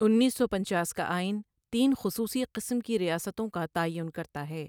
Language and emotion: Urdu, neutral